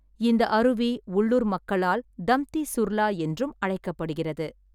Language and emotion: Tamil, neutral